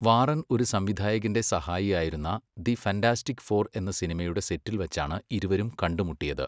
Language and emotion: Malayalam, neutral